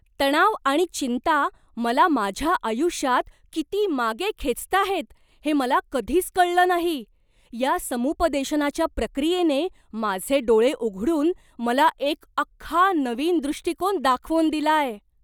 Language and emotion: Marathi, surprised